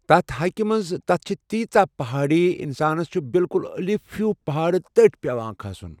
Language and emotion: Kashmiri, neutral